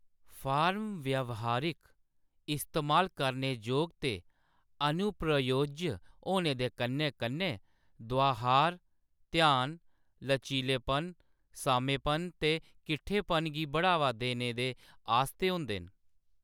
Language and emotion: Dogri, neutral